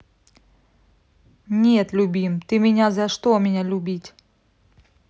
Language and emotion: Russian, neutral